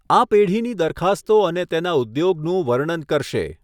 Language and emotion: Gujarati, neutral